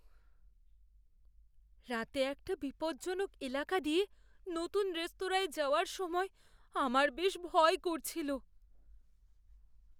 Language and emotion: Bengali, fearful